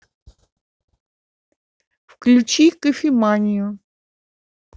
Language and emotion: Russian, neutral